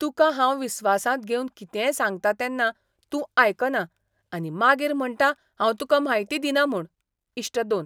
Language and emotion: Goan Konkani, disgusted